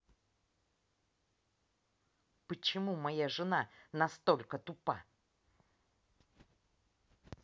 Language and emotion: Russian, angry